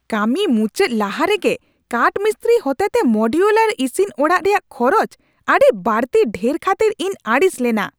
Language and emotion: Santali, angry